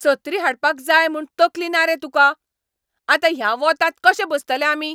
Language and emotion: Goan Konkani, angry